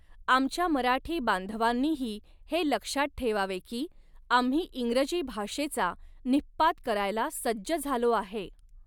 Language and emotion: Marathi, neutral